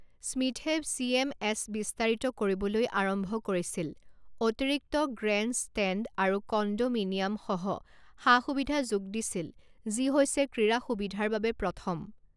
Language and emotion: Assamese, neutral